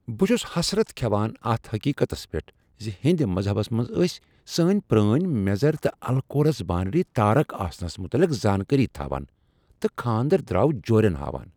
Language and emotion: Kashmiri, surprised